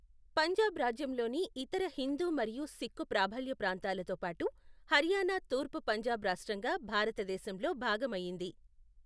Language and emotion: Telugu, neutral